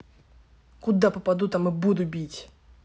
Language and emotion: Russian, angry